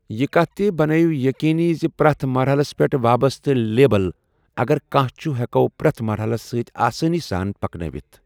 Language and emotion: Kashmiri, neutral